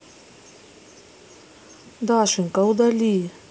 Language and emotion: Russian, sad